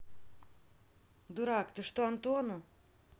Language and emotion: Russian, angry